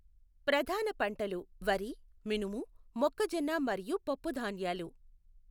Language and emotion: Telugu, neutral